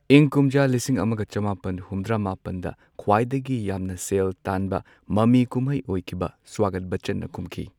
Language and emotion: Manipuri, neutral